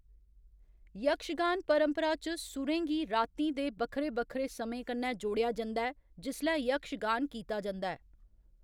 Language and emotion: Dogri, neutral